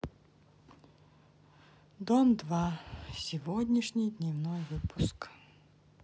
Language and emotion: Russian, sad